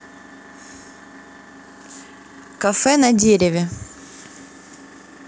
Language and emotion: Russian, neutral